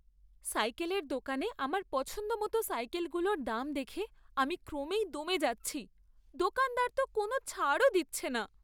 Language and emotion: Bengali, sad